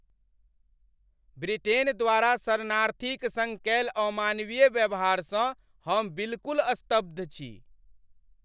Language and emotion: Maithili, angry